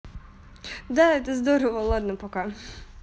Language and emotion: Russian, neutral